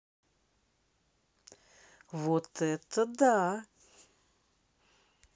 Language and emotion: Russian, positive